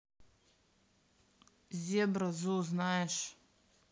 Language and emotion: Russian, neutral